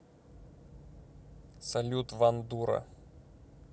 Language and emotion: Russian, neutral